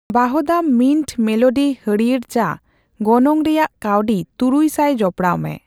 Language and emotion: Santali, neutral